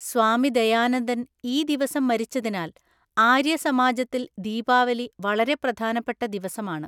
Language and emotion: Malayalam, neutral